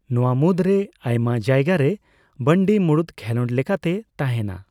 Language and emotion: Santali, neutral